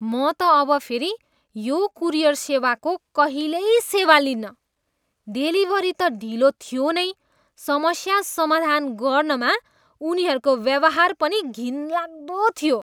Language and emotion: Nepali, disgusted